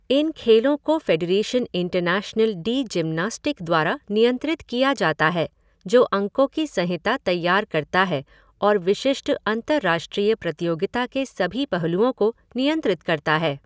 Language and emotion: Hindi, neutral